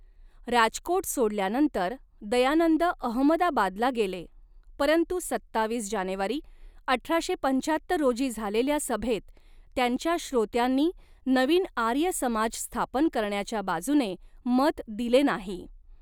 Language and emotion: Marathi, neutral